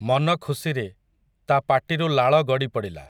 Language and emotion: Odia, neutral